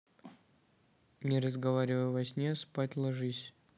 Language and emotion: Russian, neutral